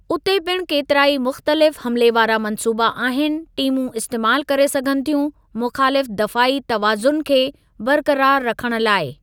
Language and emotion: Sindhi, neutral